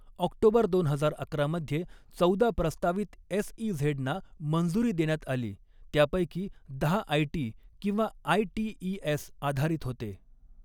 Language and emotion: Marathi, neutral